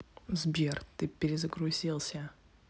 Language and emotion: Russian, neutral